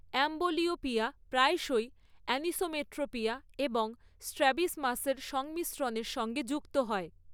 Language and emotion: Bengali, neutral